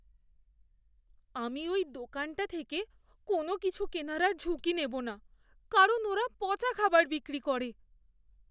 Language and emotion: Bengali, fearful